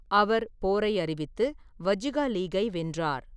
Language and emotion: Tamil, neutral